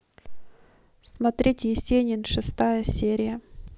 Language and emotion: Russian, neutral